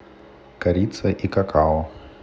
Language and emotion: Russian, neutral